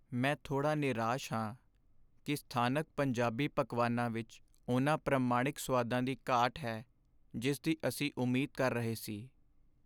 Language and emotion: Punjabi, sad